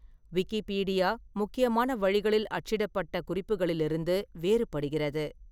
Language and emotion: Tamil, neutral